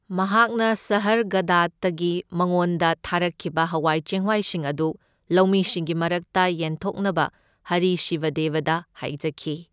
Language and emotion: Manipuri, neutral